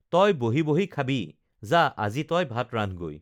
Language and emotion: Assamese, neutral